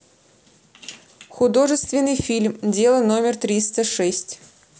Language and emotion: Russian, neutral